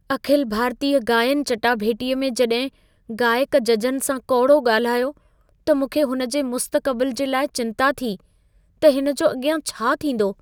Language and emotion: Sindhi, fearful